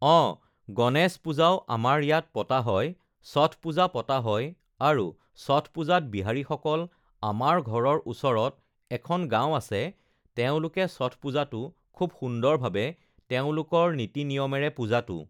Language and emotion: Assamese, neutral